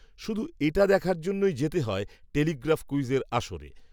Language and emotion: Bengali, neutral